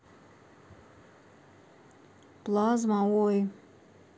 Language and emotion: Russian, neutral